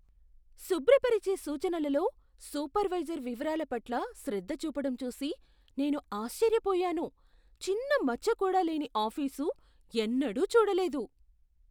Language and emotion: Telugu, surprised